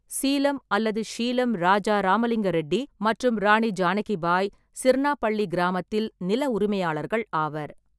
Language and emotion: Tamil, neutral